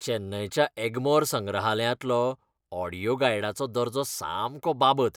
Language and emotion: Goan Konkani, disgusted